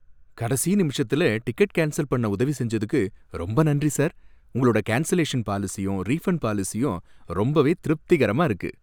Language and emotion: Tamil, happy